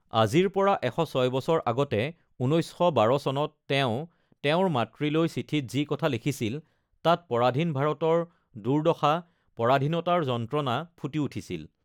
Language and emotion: Assamese, neutral